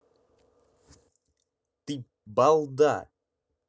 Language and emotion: Russian, angry